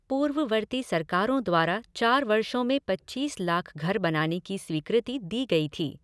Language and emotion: Hindi, neutral